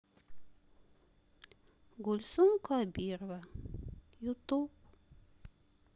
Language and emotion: Russian, sad